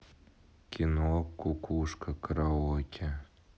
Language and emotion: Russian, neutral